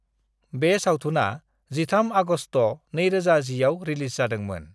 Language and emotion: Bodo, neutral